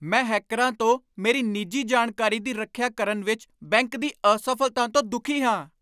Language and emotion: Punjabi, angry